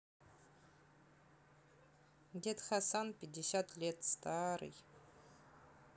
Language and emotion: Russian, neutral